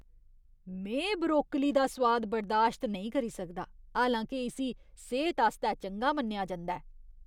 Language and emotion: Dogri, disgusted